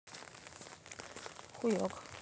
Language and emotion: Russian, neutral